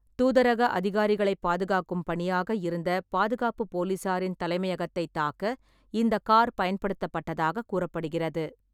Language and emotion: Tamil, neutral